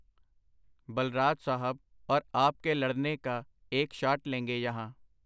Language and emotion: Punjabi, neutral